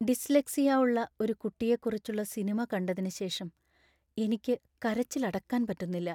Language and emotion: Malayalam, sad